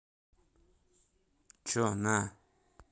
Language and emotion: Russian, angry